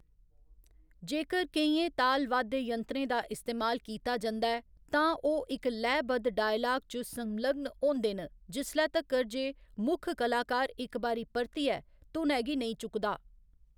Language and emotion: Dogri, neutral